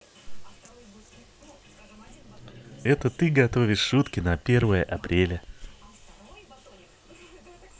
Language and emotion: Russian, positive